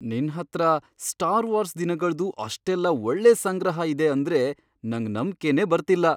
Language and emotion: Kannada, surprised